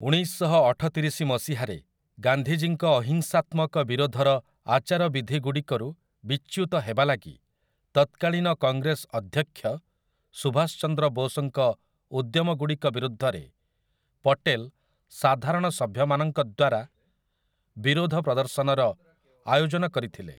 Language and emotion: Odia, neutral